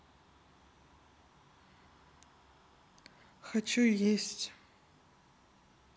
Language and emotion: Russian, neutral